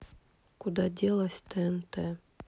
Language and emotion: Russian, sad